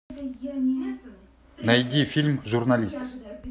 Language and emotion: Russian, neutral